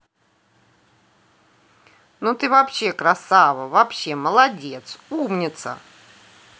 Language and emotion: Russian, positive